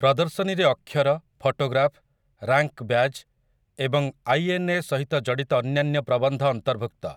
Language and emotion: Odia, neutral